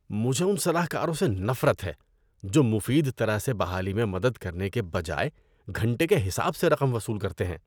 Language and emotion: Urdu, disgusted